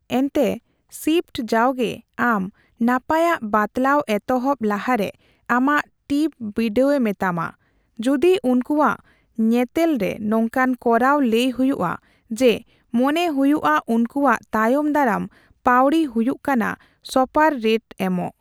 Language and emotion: Santali, neutral